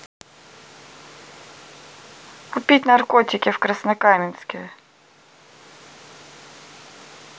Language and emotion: Russian, neutral